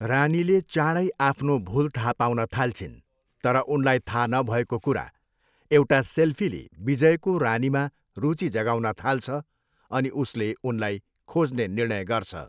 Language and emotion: Nepali, neutral